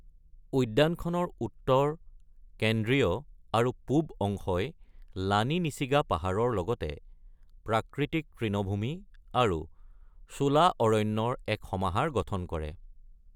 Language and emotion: Assamese, neutral